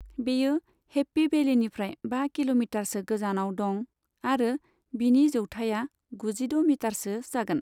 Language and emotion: Bodo, neutral